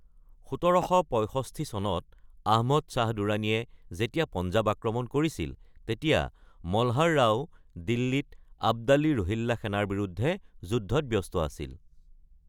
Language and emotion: Assamese, neutral